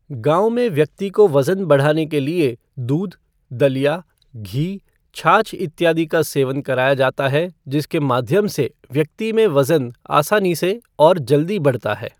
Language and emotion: Hindi, neutral